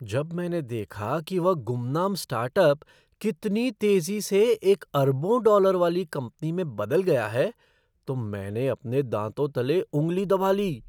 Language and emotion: Hindi, surprised